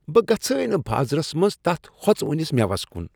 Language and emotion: Kashmiri, disgusted